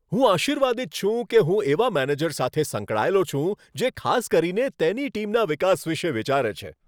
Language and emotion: Gujarati, happy